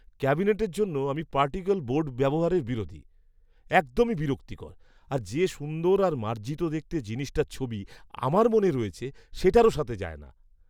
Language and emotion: Bengali, disgusted